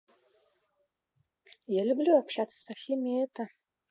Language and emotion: Russian, neutral